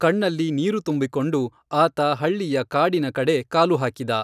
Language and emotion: Kannada, neutral